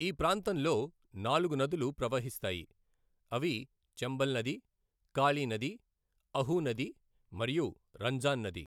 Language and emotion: Telugu, neutral